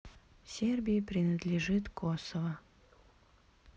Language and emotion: Russian, sad